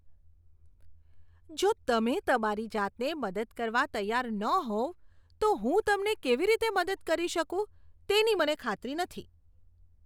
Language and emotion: Gujarati, disgusted